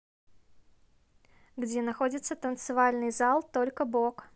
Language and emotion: Russian, neutral